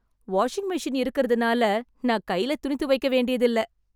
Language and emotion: Tamil, happy